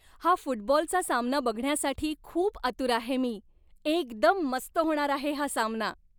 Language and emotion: Marathi, happy